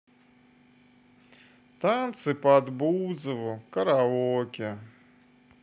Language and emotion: Russian, neutral